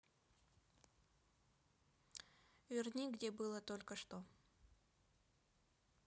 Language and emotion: Russian, neutral